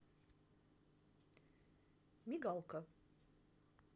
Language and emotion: Russian, neutral